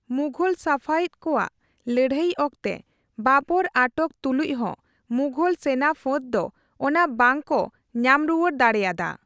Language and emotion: Santali, neutral